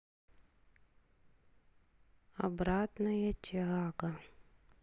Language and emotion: Russian, sad